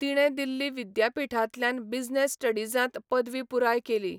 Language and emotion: Goan Konkani, neutral